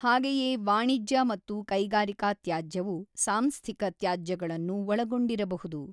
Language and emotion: Kannada, neutral